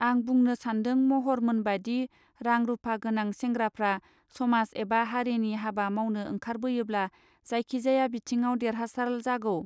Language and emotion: Bodo, neutral